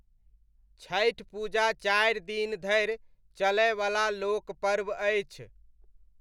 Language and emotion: Maithili, neutral